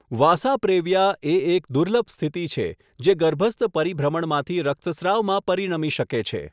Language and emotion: Gujarati, neutral